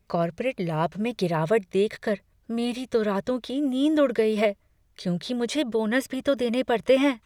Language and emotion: Hindi, fearful